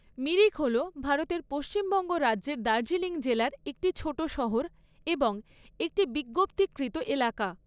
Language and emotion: Bengali, neutral